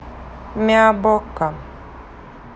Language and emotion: Russian, neutral